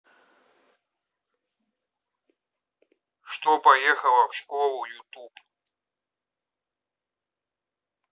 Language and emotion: Russian, neutral